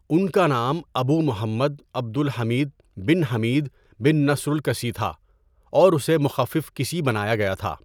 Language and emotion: Urdu, neutral